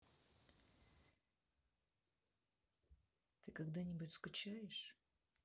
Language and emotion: Russian, neutral